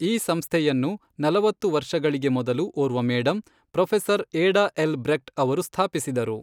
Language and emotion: Kannada, neutral